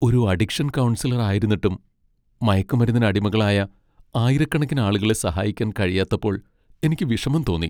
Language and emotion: Malayalam, sad